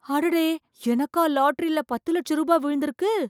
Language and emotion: Tamil, surprised